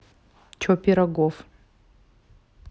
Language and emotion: Russian, neutral